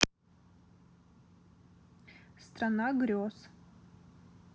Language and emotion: Russian, neutral